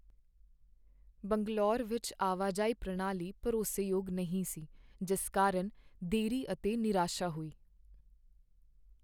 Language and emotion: Punjabi, sad